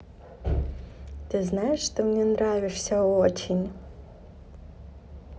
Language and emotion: Russian, positive